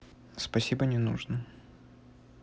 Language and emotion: Russian, neutral